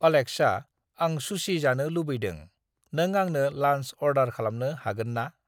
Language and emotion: Bodo, neutral